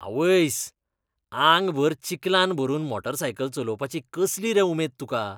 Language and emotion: Goan Konkani, disgusted